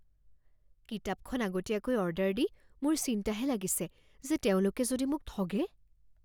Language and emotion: Assamese, fearful